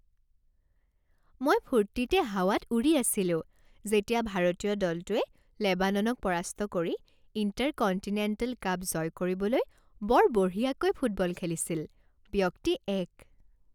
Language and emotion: Assamese, happy